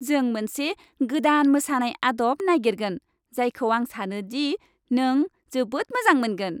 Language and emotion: Bodo, happy